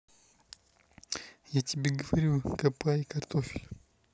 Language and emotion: Russian, neutral